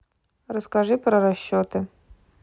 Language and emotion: Russian, neutral